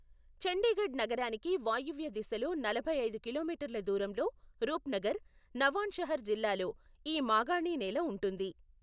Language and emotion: Telugu, neutral